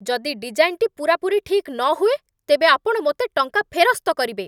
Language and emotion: Odia, angry